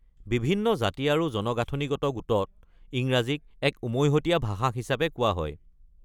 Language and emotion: Assamese, neutral